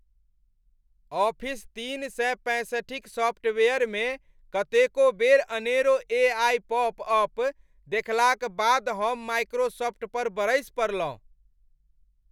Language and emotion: Maithili, angry